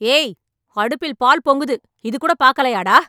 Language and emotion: Tamil, angry